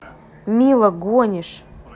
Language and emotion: Russian, neutral